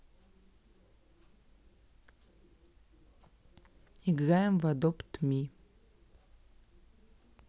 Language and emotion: Russian, neutral